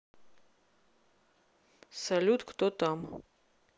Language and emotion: Russian, neutral